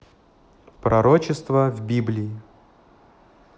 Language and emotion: Russian, neutral